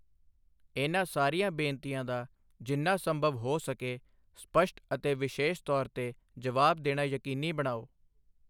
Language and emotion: Punjabi, neutral